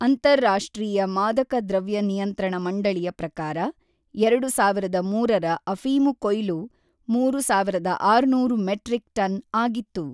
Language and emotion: Kannada, neutral